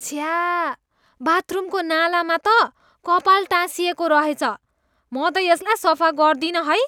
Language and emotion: Nepali, disgusted